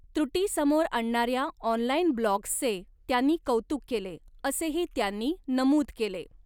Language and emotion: Marathi, neutral